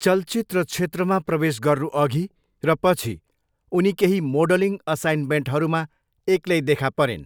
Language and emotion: Nepali, neutral